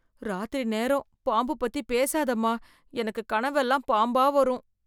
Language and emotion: Tamil, fearful